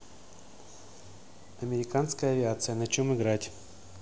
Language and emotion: Russian, neutral